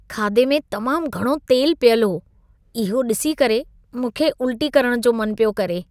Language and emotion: Sindhi, disgusted